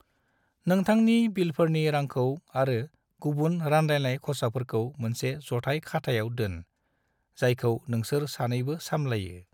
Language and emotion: Bodo, neutral